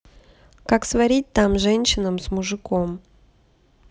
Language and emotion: Russian, neutral